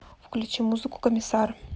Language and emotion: Russian, neutral